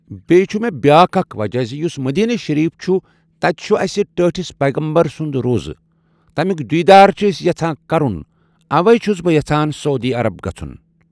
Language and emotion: Kashmiri, neutral